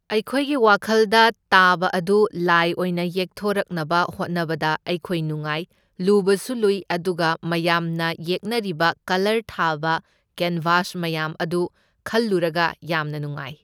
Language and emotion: Manipuri, neutral